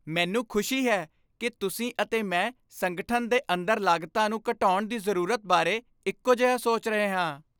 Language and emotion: Punjabi, happy